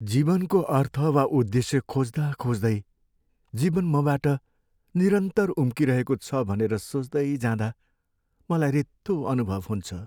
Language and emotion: Nepali, sad